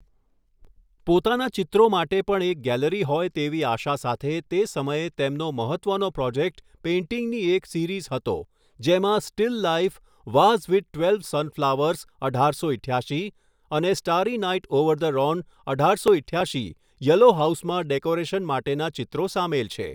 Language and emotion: Gujarati, neutral